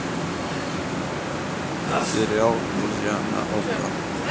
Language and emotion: Russian, neutral